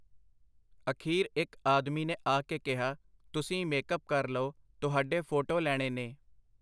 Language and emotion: Punjabi, neutral